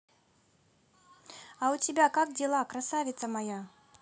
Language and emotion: Russian, positive